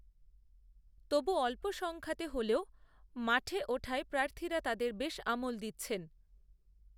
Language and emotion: Bengali, neutral